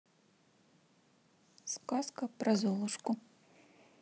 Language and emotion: Russian, neutral